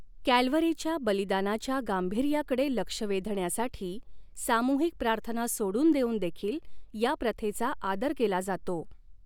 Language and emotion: Marathi, neutral